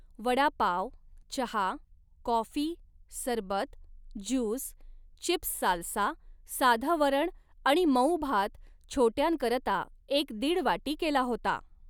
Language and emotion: Marathi, neutral